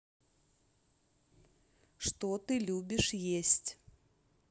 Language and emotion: Russian, neutral